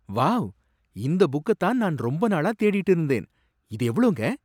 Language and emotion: Tamil, surprised